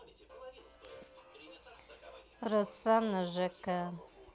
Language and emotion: Russian, neutral